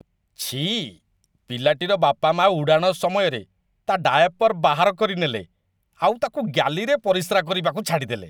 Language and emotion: Odia, disgusted